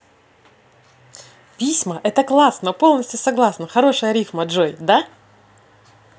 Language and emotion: Russian, positive